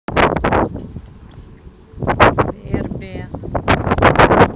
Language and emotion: Russian, neutral